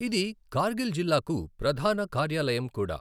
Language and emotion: Telugu, neutral